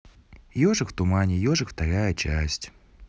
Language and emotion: Russian, neutral